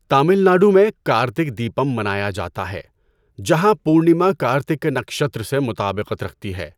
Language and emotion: Urdu, neutral